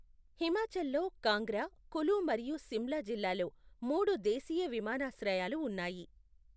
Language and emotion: Telugu, neutral